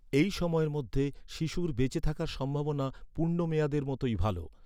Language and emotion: Bengali, neutral